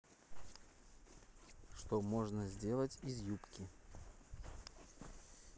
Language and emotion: Russian, neutral